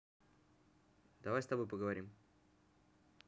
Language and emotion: Russian, neutral